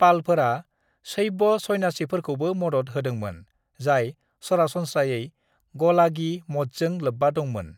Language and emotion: Bodo, neutral